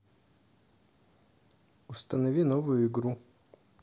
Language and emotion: Russian, neutral